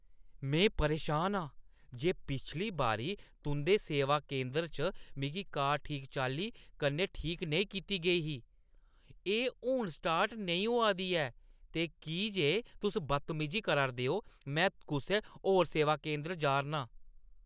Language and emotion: Dogri, angry